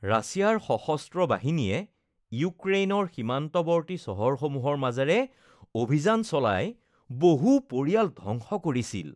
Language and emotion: Assamese, disgusted